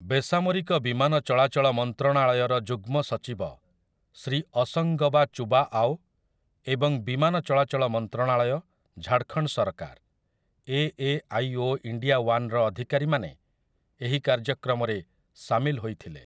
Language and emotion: Odia, neutral